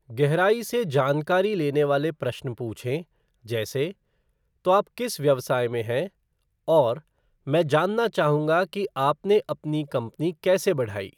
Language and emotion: Hindi, neutral